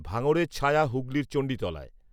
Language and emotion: Bengali, neutral